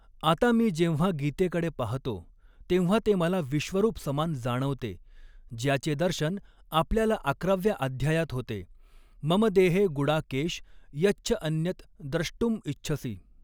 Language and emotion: Marathi, neutral